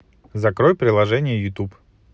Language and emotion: Russian, positive